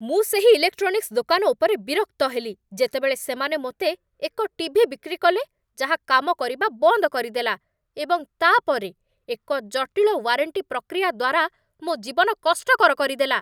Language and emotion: Odia, angry